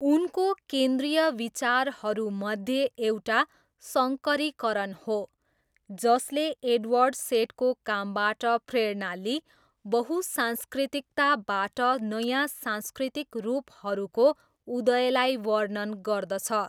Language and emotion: Nepali, neutral